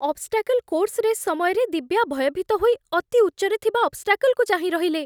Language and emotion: Odia, fearful